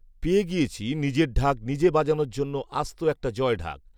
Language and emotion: Bengali, neutral